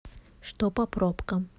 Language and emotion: Russian, neutral